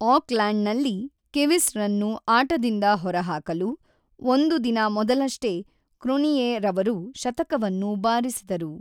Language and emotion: Kannada, neutral